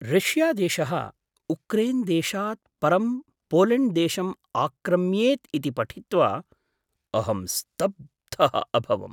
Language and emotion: Sanskrit, surprised